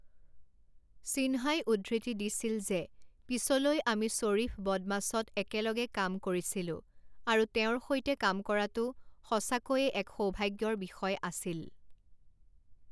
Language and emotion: Assamese, neutral